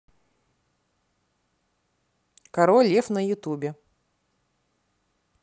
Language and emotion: Russian, neutral